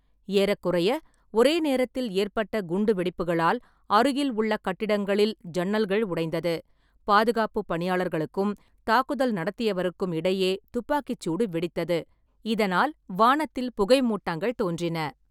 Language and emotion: Tamil, neutral